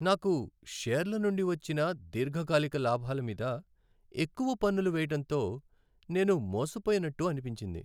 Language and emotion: Telugu, sad